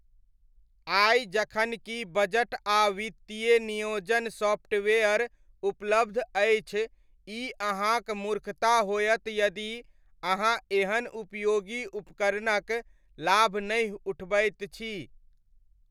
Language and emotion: Maithili, neutral